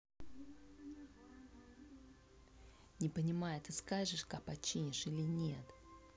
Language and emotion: Russian, neutral